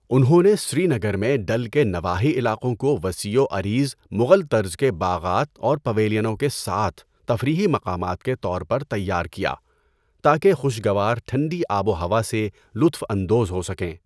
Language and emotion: Urdu, neutral